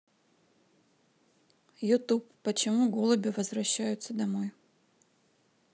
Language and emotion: Russian, neutral